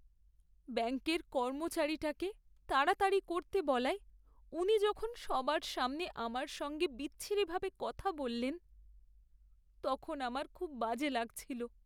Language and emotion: Bengali, sad